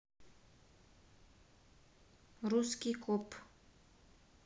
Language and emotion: Russian, neutral